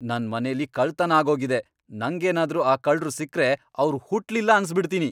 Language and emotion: Kannada, angry